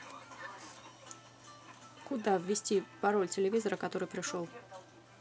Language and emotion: Russian, neutral